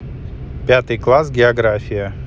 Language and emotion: Russian, neutral